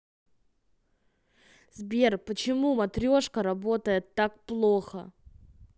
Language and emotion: Russian, angry